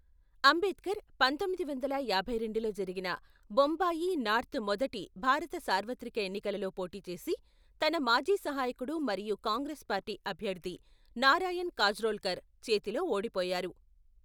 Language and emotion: Telugu, neutral